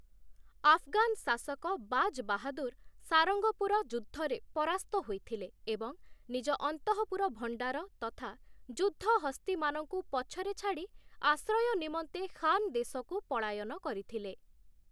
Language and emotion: Odia, neutral